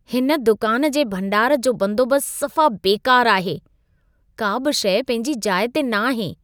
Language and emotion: Sindhi, disgusted